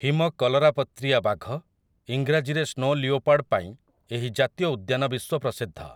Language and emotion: Odia, neutral